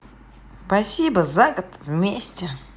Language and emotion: Russian, positive